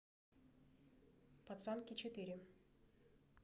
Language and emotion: Russian, neutral